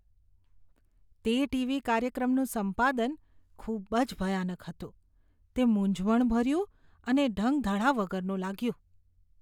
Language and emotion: Gujarati, disgusted